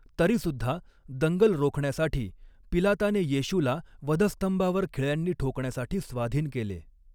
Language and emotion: Marathi, neutral